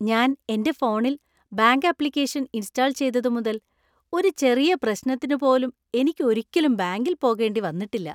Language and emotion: Malayalam, happy